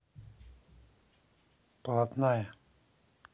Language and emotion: Russian, neutral